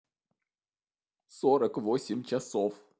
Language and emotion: Russian, sad